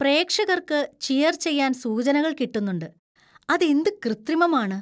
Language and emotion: Malayalam, disgusted